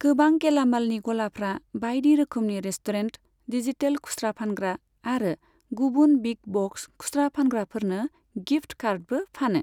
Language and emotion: Bodo, neutral